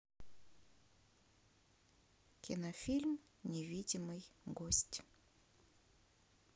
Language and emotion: Russian, neutral